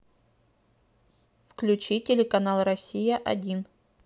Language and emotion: Russian, neutral